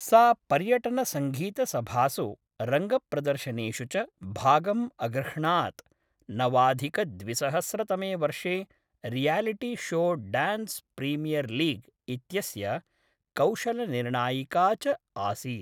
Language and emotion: Sanskrit, neutral